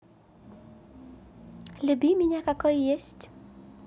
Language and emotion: Russian, positive